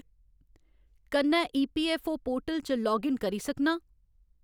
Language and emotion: Dogri, neutral